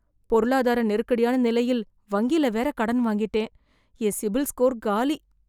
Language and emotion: Tamil, fearful